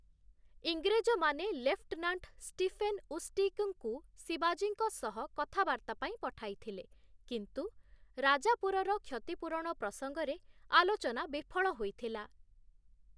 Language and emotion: Odia, neutral